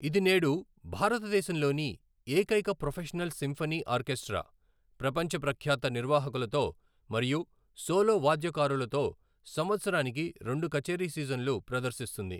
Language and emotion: Telugu, neutral